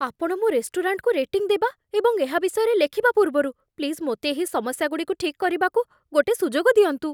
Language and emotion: Odia, fearful